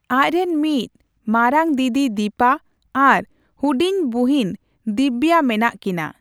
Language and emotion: Santali, neutral